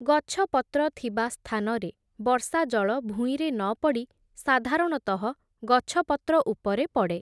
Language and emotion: Odia, neutral